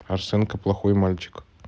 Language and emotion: Russian, neutral